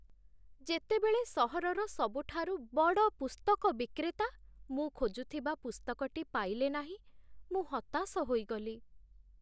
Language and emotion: Odia, sad